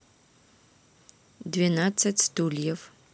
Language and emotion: Russian, neutral